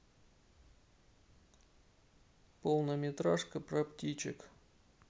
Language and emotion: Russian, sad